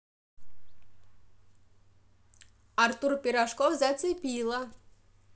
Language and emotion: Russian, positive